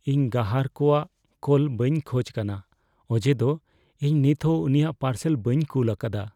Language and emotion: Santali, fearful